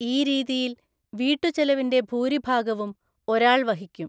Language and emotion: Malayalam, neutral